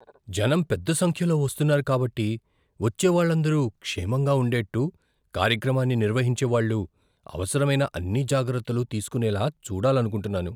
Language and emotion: Telugu, fearful